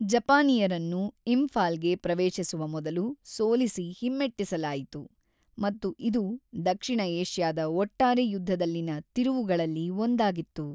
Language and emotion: Kannada, neutral